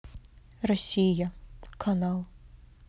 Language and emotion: Russian, neutral